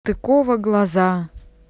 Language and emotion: Russian, neutral